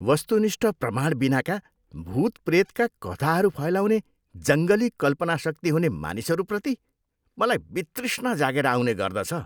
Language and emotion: Nepali, disgusted